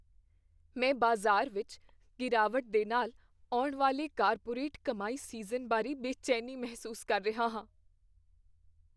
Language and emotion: Punjabi, fearful